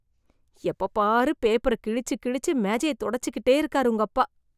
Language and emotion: Tamil, disgusted